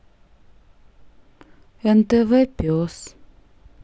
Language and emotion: Russian, sad